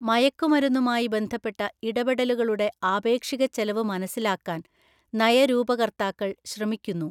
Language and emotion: Malayalam, neutral